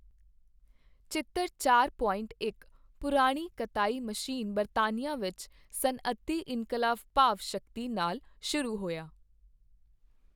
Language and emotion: Punjabi, neutral